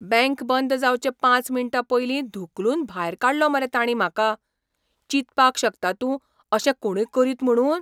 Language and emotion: Goan Konkani, surprised